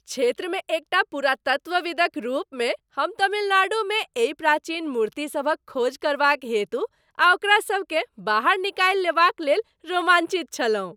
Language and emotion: Maithili, happy